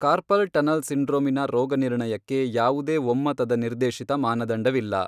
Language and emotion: Kannada, neutral